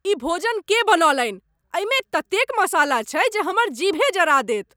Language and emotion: Maithili, angry